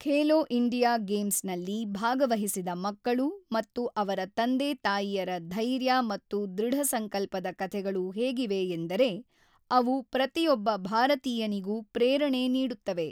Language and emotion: Kannada, neutral